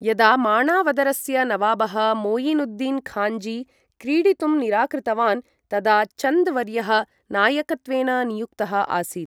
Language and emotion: Sanskrit, neutral